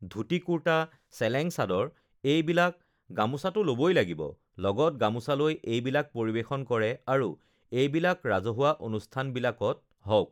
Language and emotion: Assamese, neutral